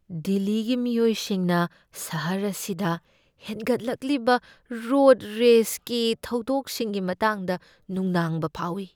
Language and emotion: Manipuri, fearful